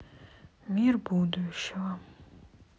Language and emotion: Russian, sad